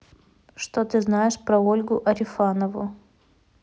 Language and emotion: Russian, neutral